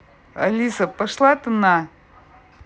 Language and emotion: Russian, angry